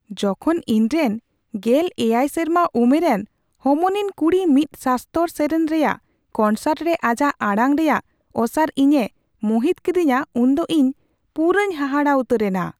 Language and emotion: Santali, surprised